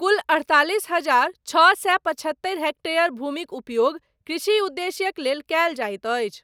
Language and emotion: Maithili, neutral